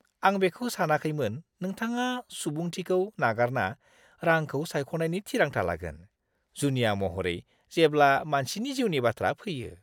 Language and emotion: Bodo, disgusted